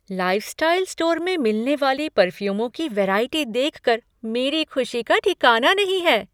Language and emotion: Hindi, surprised